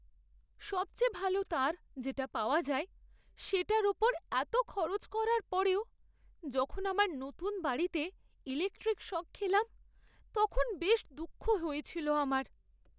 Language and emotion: Bengali, sad